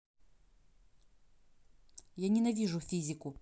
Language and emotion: Russian, angry